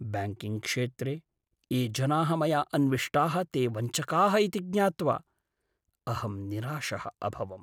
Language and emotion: Sanskrit, sad